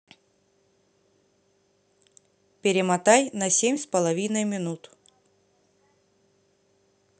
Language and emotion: Russian, neutral